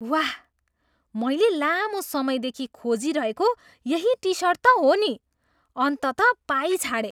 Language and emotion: Nepali, surprised